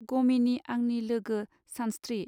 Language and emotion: Bodo, neutral